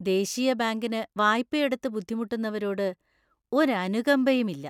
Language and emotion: Malayalam, disgusted